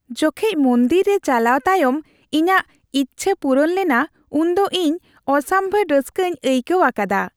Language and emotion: Santali, happy